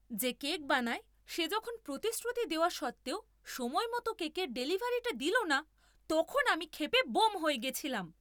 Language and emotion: Bengali, angry